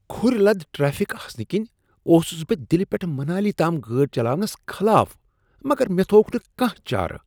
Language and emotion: Kashmiri, disgusted